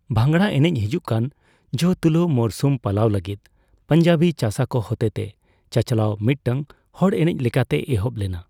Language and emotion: Santali, neutral